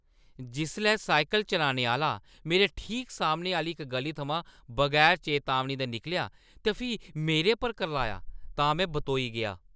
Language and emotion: Dogri, angry